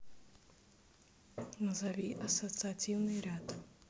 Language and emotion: Russian, neutral